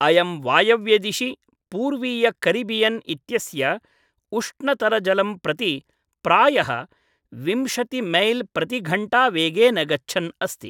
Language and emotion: Sanskrit, neutral